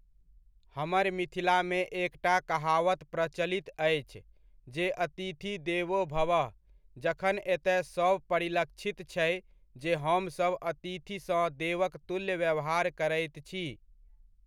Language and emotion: Maithili, neutral